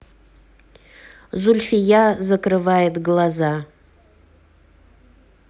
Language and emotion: Russian, neutral